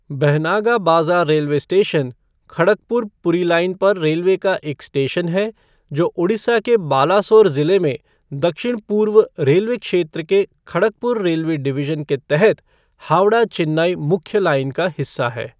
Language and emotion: Hindi, neutral